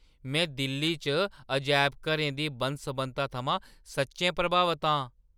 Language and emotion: Dogri, surprised